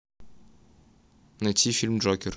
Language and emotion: Russian, neutral